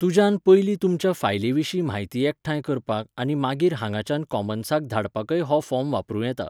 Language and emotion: Goan Konkani, neutral